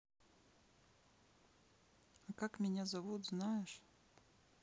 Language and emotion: Russian, neutral